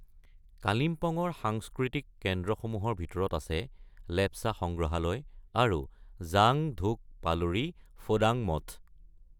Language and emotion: Assamese, neutral